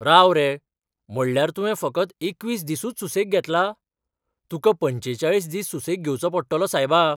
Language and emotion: Goan Konkani, surprised